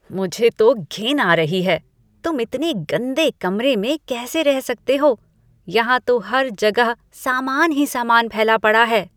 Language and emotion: Hindi, disgusted